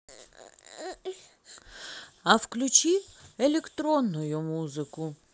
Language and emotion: Russian, neutral